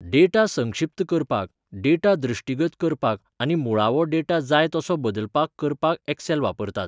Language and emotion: Goan Konkani, neutral